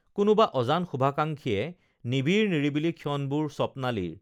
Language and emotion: Assamese, neutral